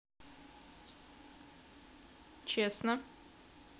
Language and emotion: Russian, neutral